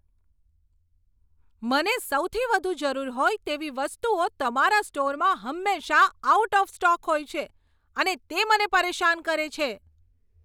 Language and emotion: Gujarati, angry